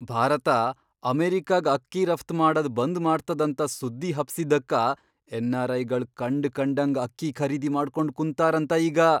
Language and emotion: Kannada, surprised